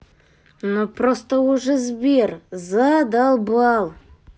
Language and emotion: Russian, angry